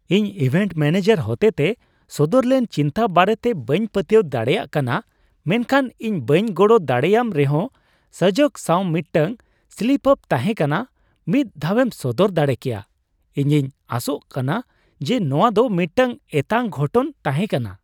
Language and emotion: Santali, surprised